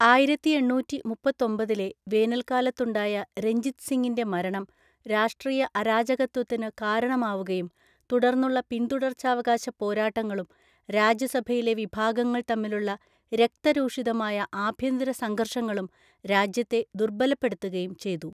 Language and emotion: Malayalam, neutral